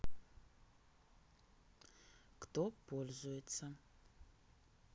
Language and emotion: Russian, neutral